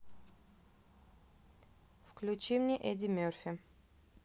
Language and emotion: Russian, neutral